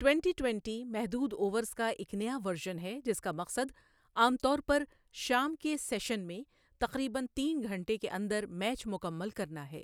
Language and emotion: Urdu, neutral